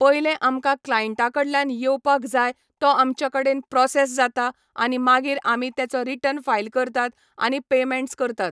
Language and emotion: Goan Konkani, neutral